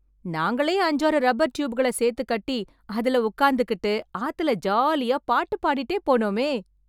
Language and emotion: Tamil, happy